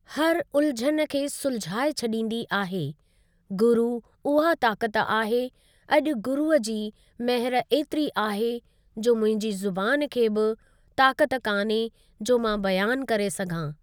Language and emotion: Sindhi, neutral